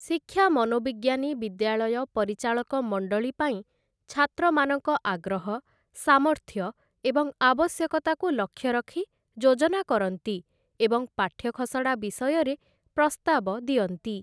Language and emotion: Odia, neutral